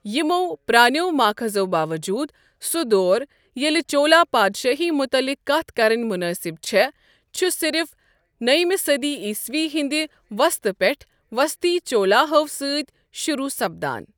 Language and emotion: Kashmiri, neutral